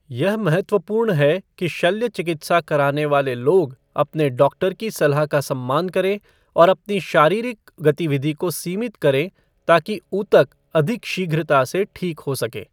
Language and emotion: Hindi, neutral